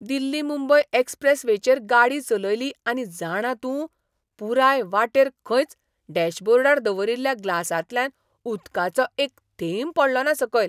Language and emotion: Goan Konkani, surprised